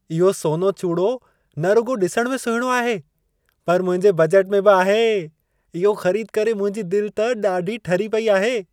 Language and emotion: Sindhi, happy